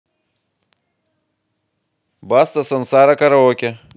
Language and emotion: Russian, positive